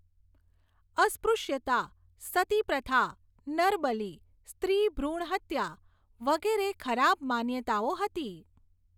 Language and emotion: Gujarati, neutral